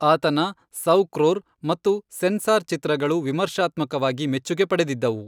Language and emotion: Kannada, neutral